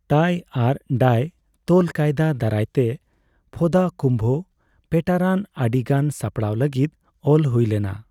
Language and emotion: Santali, neutral